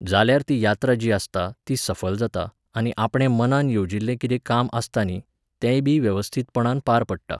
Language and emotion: Goan Konkani, neutral